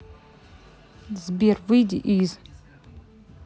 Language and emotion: Russian, neutral